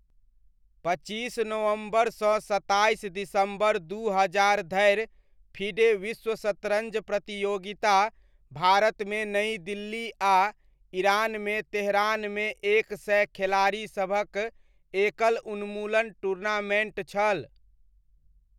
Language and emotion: Maithili, neutral